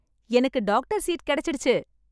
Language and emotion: Tamil, happy